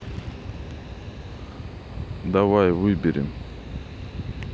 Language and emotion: Russian, neutral